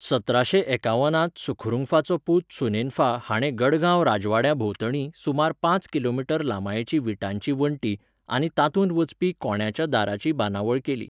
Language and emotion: Goan Konkani, neutral